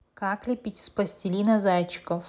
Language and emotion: Russian, neutral